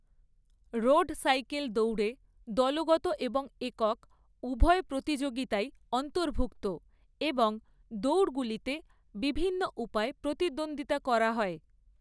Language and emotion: Bengali, neutral